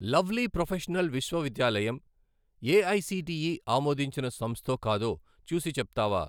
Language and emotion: Telugu, neutral